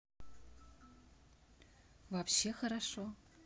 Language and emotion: Russian, neutral